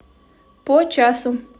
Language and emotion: Russian, neutral